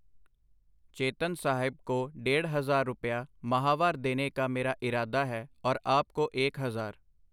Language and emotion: Punjabi, neutral